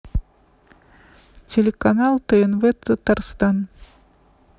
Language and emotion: Russian, neutral